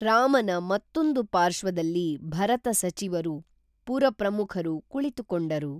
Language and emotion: Kannada, neutral